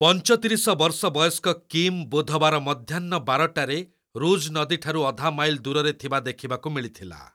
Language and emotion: Odia, neutral